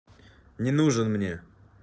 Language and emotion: Russian, angry